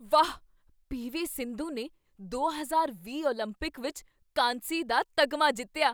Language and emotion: Punjabi, surprised